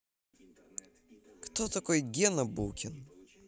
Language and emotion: Russian, neutral